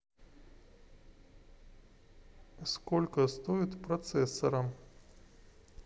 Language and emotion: Russian, neutral